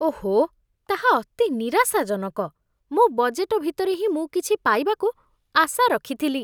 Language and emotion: Odia, disgusted